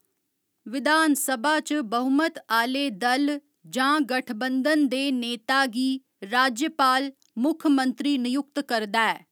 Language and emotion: Dogri, neutral